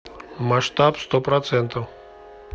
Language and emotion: Russian, neutral